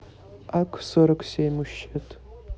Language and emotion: Russian, neutral